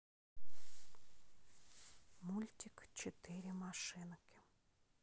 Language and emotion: Russian, neutral